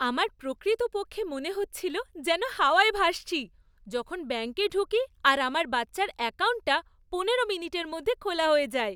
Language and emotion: Bengali, happy